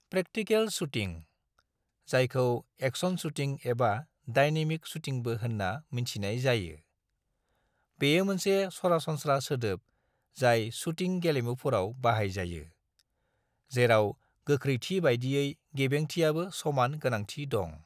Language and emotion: Bodo, neutral